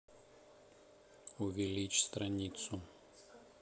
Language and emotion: Russian, neutral